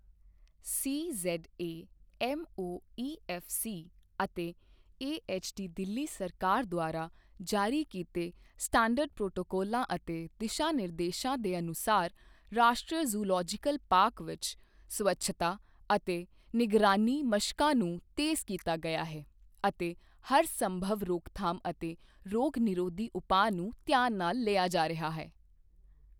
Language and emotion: Punjabi, neutral